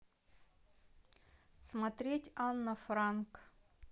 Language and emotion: Russian, neutral